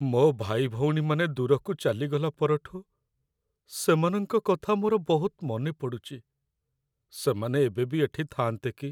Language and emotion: Odia, sad